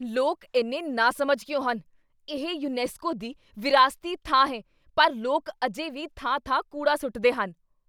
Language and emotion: Punjabi, angry